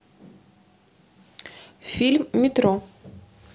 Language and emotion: Russian, neutral